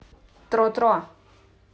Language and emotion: Russian, neutral